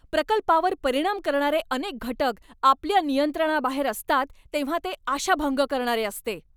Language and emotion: Marathi, angry